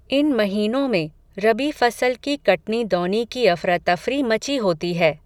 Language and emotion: Hindi, neutral